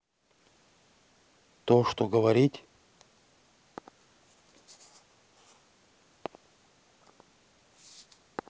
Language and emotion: Russian, neutral